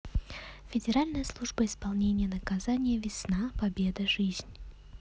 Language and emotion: Russian, neutral